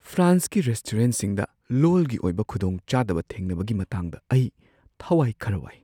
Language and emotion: Manipuri, fearful